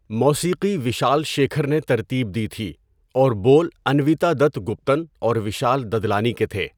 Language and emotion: Urdu, neutral